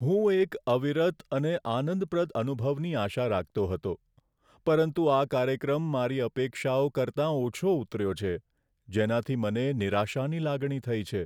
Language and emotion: Gujarati, sad